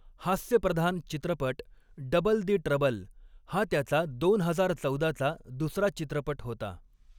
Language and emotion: Marathi, neutral